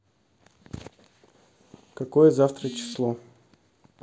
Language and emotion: Russian, neutral